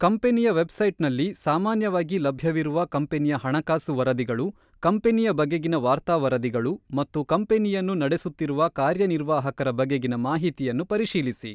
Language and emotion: Kannada, neutral